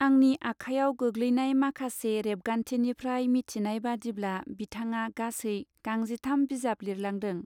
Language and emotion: Bodo, neutral